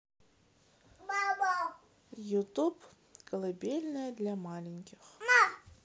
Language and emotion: Russian, neutral